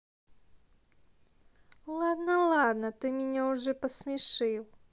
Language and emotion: Russian, neutral